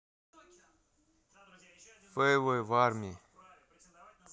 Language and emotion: Russian, neutral